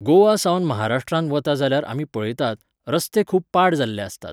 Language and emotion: Goan Konkani, neutral